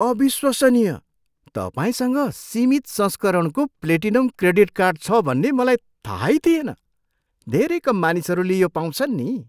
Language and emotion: Nepali, surprised